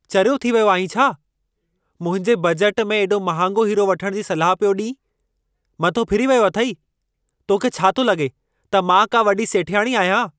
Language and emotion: Sindhi, angry